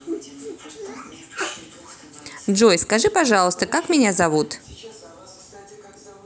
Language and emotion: Russian, positive